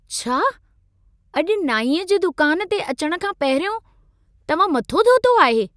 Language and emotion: Sindhi, surprised